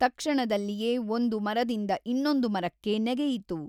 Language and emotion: Kannada, neutral